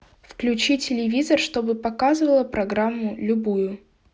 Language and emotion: Russian, neutral